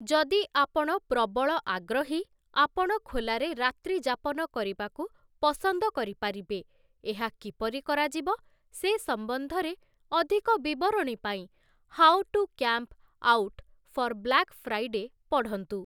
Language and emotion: Odia, neutral